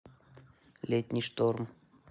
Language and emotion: Russian, neutral